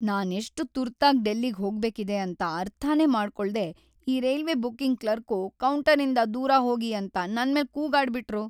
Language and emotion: Kannada, sad